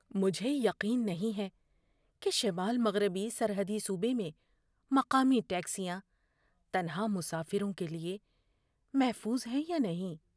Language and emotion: Urdu, fearful